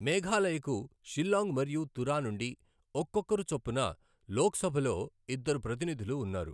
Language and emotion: Telugu, neutral